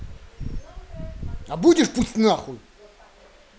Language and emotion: Russian, angry